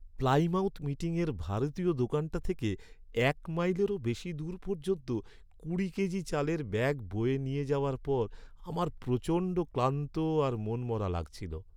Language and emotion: Bengali, sad